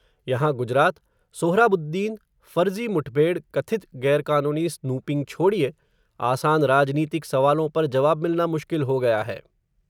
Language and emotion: Hindi, neutral